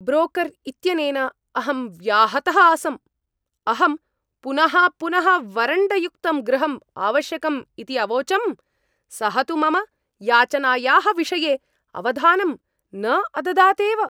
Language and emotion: Sanskrit, angry